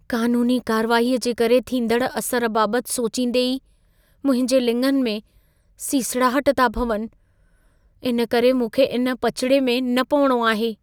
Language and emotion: Sindhi, fearful